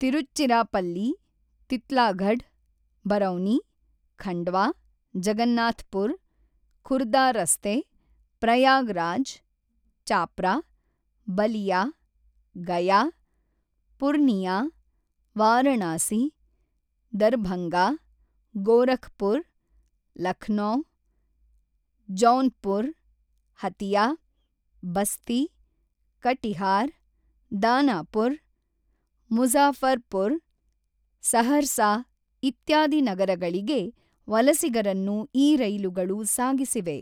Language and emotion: Kannada, neutral